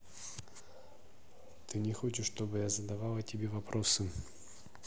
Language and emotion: Russian, sad